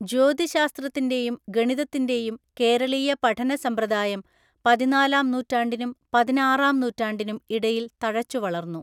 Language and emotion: Malayalam, neutral